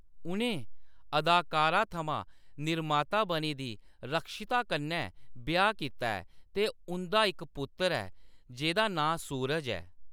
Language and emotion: Dogri, neutral